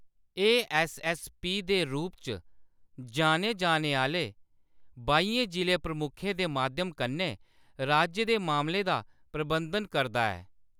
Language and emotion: Dogri, neutral